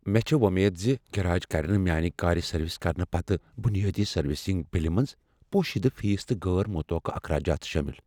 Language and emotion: Kashmiri, fearful